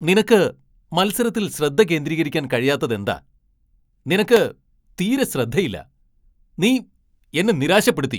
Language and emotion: Malayalam, angry